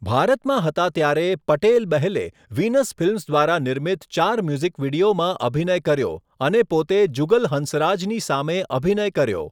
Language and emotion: Gujarati, neutral